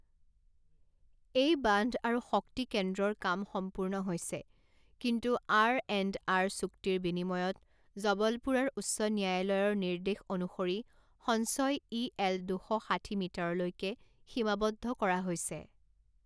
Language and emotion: Assamese, neutral